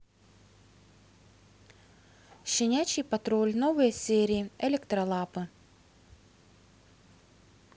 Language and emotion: Russian, neutral